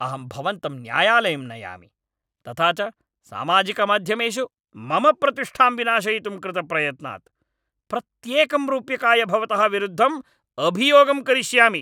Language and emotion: Sanskrit, angry